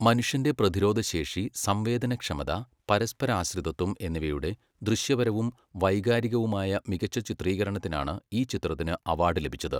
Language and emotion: Malayalam, neutral